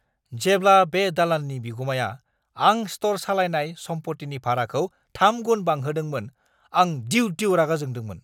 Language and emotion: Bodo, angry